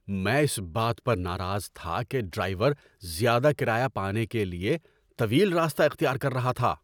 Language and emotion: Urdu, angry